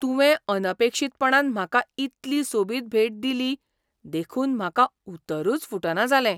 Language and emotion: Goan Konkani, surprised